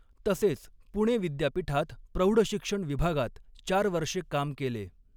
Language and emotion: Marathi, neutral